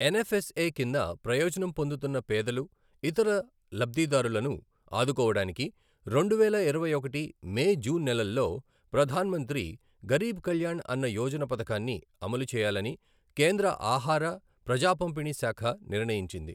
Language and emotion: Telugu, neutral